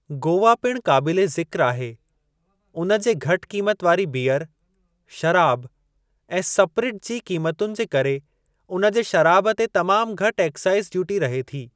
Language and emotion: Sindhi, neutral